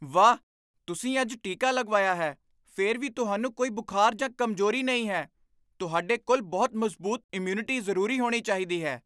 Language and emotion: Punjabi, surprised